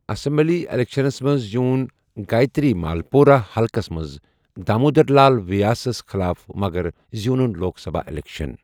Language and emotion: Kashmiri, neutral